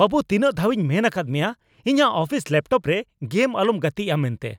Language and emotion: Santali, angry